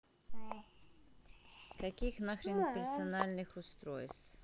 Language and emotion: Russian, neutral